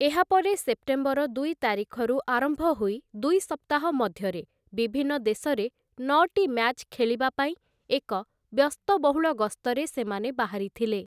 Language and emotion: Odia, neutral